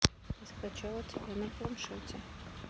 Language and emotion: Russian, neutral